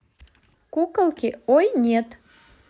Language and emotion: Russian, positive